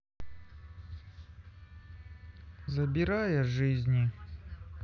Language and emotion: Russian, sad